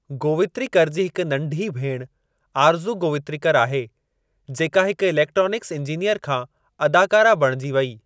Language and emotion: Sindhi, neutral